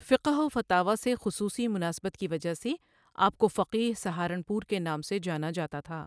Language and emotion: Urdu, neutral